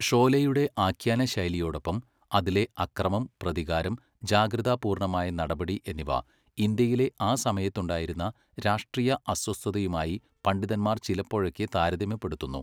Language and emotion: Malayalam, neutral